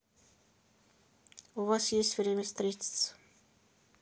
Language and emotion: Russian, neutral